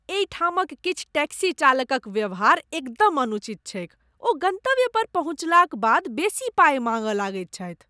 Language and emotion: Maithili, disgusted